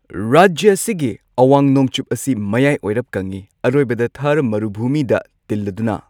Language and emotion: Manipuri, neutral